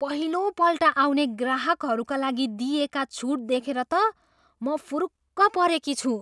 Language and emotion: Nepali, surprised